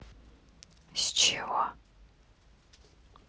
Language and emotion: Russian, neutral